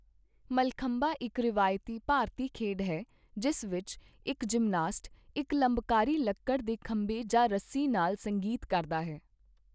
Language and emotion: Punjabi, neutral